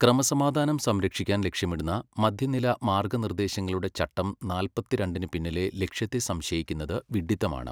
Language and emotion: Malayalam, neutral